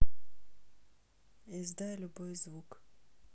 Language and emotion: Russian, neutral